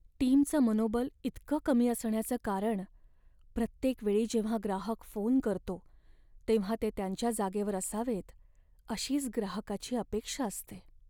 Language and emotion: Marathi, sad